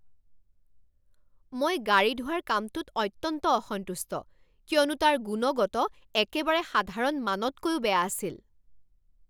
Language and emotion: Assamese, angry